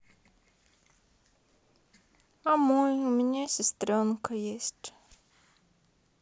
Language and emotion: Russian, sad